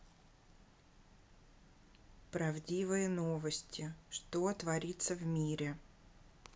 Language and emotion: Russian, neutral